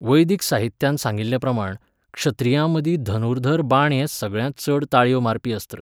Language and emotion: Goan Konkani, neutral